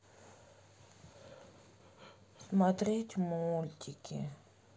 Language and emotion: Russian, sad